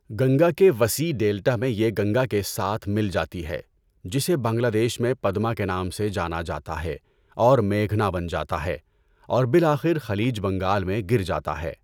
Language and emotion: Urdu, neutral